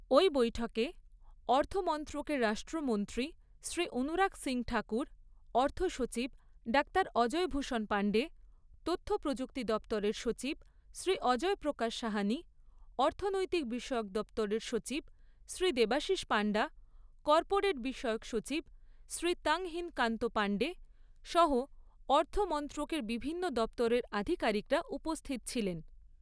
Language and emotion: Bengali, neutral